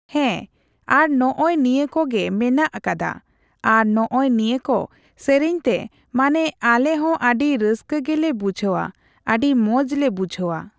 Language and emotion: Santali, neutral